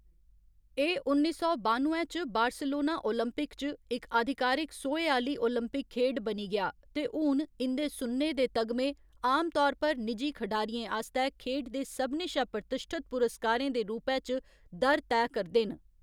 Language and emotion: Dogri, neutral